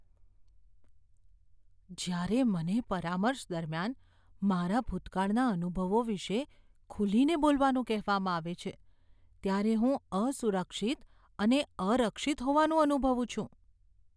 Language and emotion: Gujarati, fearful